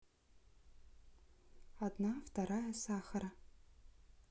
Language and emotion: Russian, neutral